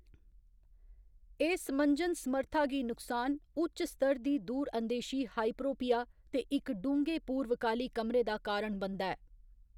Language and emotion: Dogri, neutral